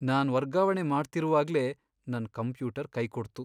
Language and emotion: Kannada, sad